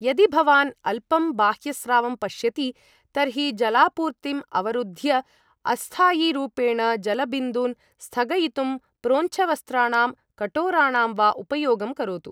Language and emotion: Sanskrit, neutral